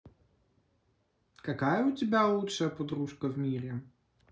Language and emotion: Russian, positive